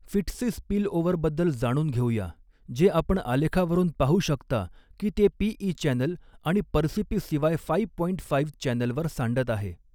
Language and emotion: Marathi, neutral